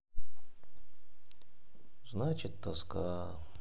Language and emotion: Russian, sad